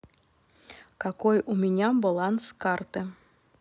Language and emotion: Russian, neutral